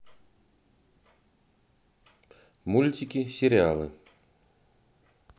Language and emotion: Russian, neutral